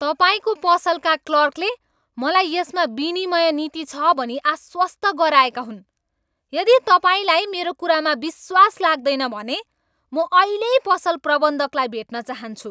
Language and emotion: Nepali, angry